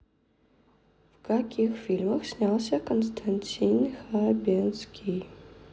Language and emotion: Russian, neutral